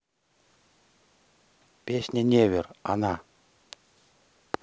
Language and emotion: Russian, neutral